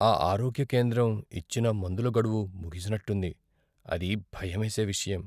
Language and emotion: Telugu, fearful